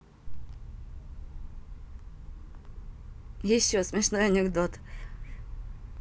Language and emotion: Russian, positive